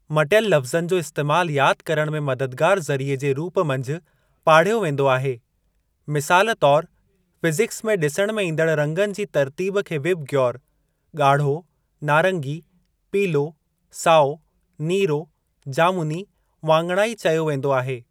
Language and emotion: Sindhi, neutral